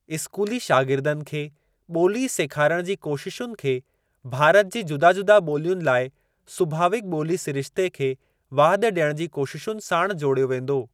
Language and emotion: Sindhi, neutral